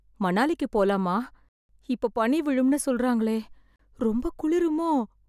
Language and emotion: Tamil, fearful